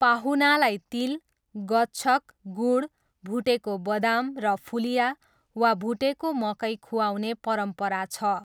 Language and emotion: Nepali, neutral